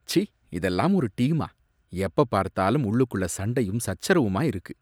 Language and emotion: Tamil, disgusted